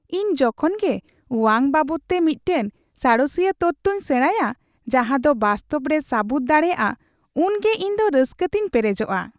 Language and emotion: Santali, happy